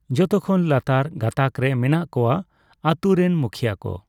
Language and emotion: Santali, neutral